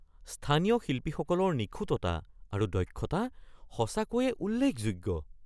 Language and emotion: Assamese, surprised